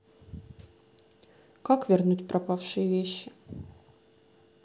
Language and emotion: Russian, sad